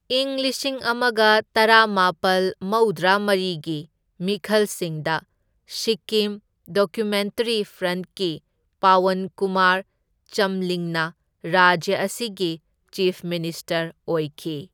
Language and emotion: Manipuri, neutral